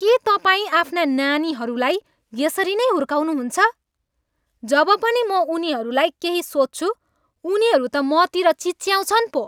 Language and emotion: Nepali, angry